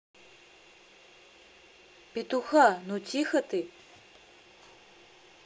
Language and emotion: Russian, angry